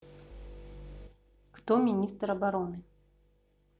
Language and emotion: Russian, neutral